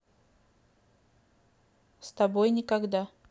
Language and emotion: Russian, neutral